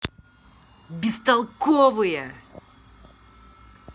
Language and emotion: Russian, angry